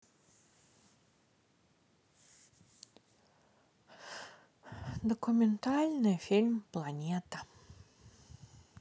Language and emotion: Russian, sad